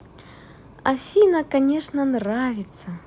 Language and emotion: Russian, positive